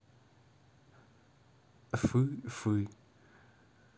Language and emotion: Russian, neutral